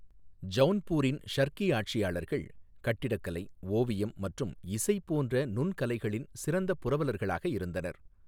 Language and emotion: Tamil, neutral